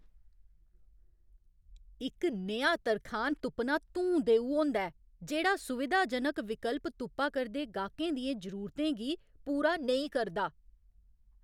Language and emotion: Dogri, angry